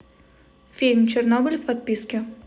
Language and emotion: Russian, neutral